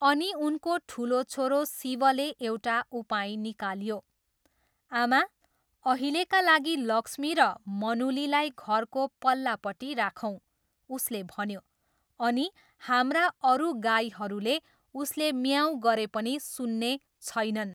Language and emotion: Nepali, neutral